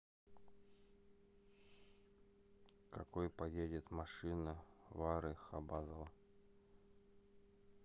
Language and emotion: Russian, neutral